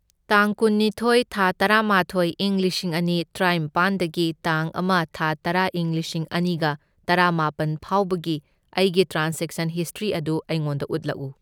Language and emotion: Manipuri, neutral